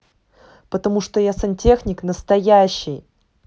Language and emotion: Russian, neutral